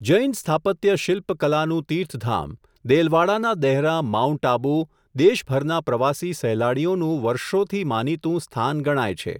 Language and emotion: Gujarati, neutral